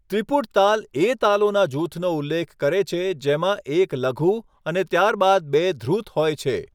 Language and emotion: Gujarati, neutral